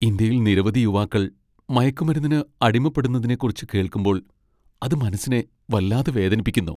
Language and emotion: Malayalam, sad